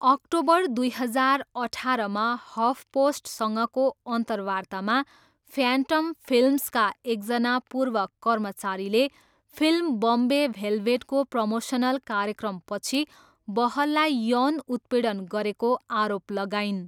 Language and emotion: Nepali, neutral